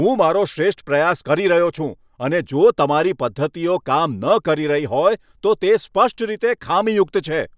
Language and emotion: Gujarati, angry